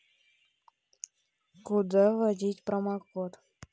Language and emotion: Russian, neutral